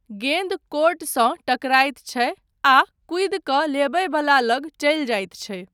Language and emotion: Maithili, neutral